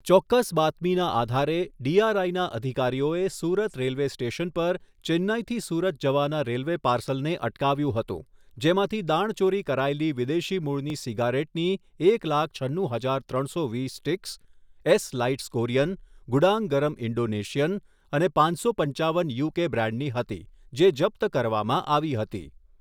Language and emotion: Gujarati, neutral